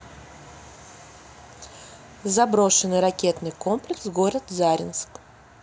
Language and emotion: Russian, neutral